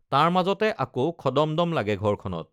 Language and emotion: Assamese, neutral